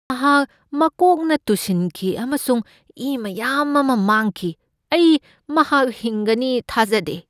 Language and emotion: Manipuri, fearful